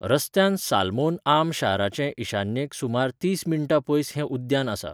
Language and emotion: Goan Konkani, neutral